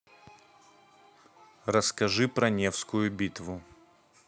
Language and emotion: Russian, neutral